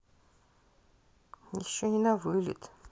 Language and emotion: Russian, neutral